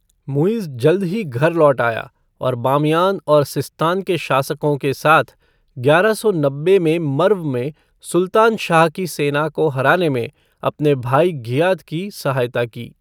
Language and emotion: Hindi, neutral